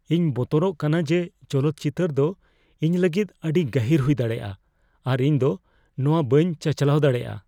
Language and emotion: Santali, fearful